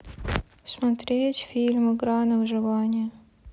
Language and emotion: Russian, neutral